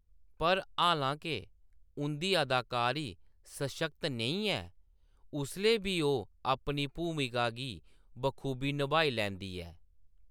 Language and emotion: Dogri, neutral